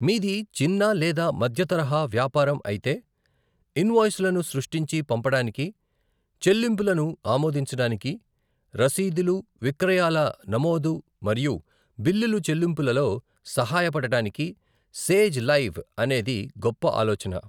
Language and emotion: Telugu, neutral